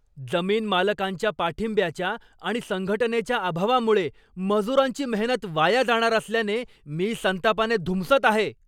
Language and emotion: Marathi, angry